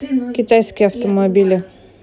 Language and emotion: Russian, neutral